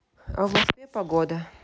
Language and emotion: Russian, neutral